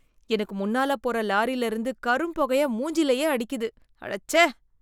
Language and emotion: Tamil, disgusted